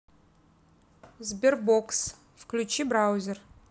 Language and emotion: Russian, neutral